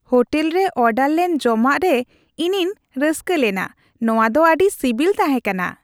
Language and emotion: Santali, happy